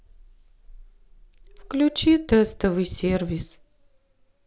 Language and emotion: Russian, sad